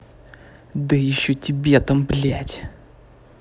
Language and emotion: Russian, angry